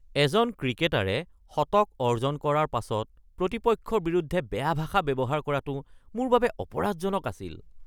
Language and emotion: Assamese, disgusted